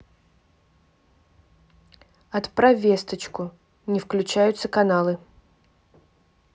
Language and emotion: Russian, neutral